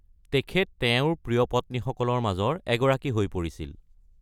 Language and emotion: Assamese, neutral